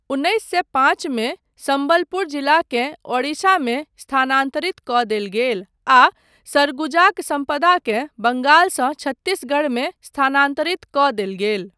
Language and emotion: Maithili, neutral